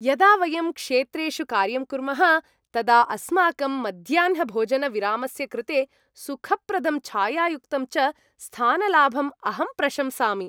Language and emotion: Sanskrit, happy